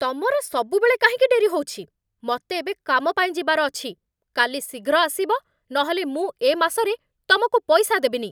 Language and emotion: Odia, angry